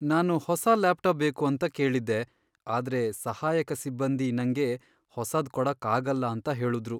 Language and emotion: Kannada, sad